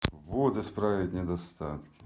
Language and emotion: Russian, neutral